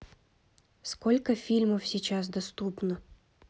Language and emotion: Russian, neutral